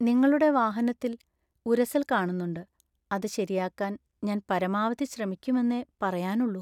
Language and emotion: Malayalam, sad